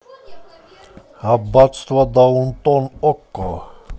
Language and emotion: Russian, positive